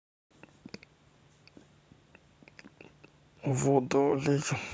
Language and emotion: Russian, neutral